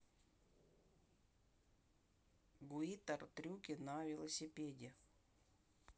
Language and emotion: Russian, neutral